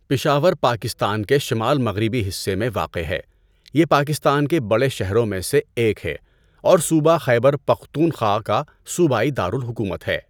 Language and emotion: Urdu, neutral